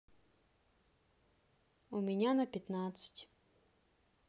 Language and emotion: Russian, neutral